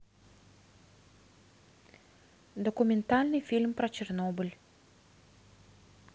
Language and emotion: Russian, neutral